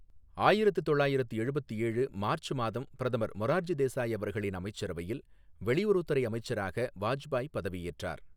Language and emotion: Tamil, neutral